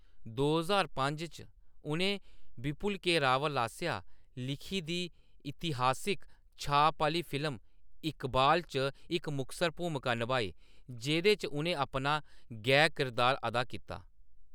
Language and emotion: Dogri, neutral